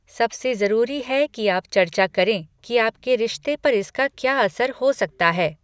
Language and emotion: Hindi, neutral